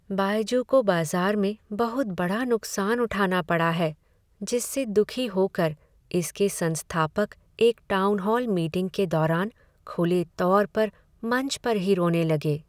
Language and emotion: Hindi, sad